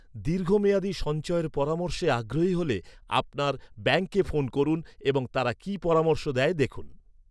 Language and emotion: Bengali, neutral